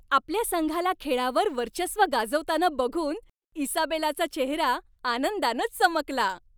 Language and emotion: Marathi, happy